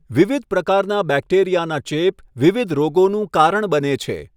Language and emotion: Gujarati, neutral